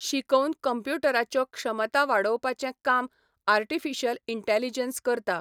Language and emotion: Goan Konkani, neutral